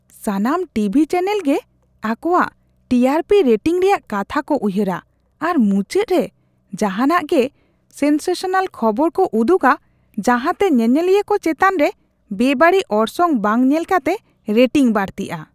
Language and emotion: Santali, disgusted